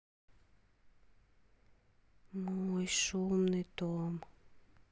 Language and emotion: Russian, sad